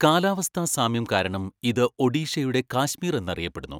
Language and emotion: Malayalam, neutral